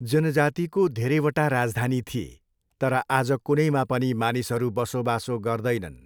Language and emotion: Nepali, neutral